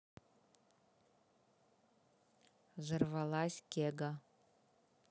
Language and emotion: Russian, neutral